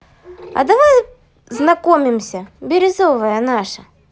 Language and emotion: Russian, positive